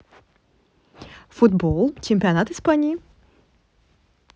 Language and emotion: Russian, neutral